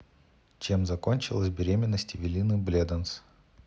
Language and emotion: Russian, neutral